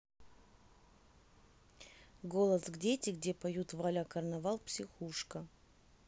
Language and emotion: Russian, neutral